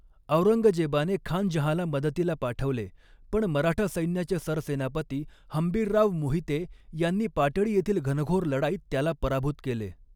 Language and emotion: Marathi, neutral